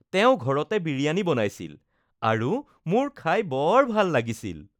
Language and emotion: Assamese, happy